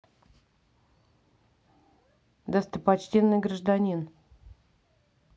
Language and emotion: Russian, neutral